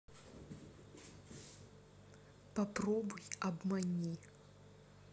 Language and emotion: Russian, angry